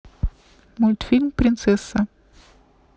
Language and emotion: Russian, neutral